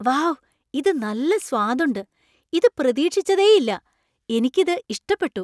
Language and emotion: Malayalam, surprised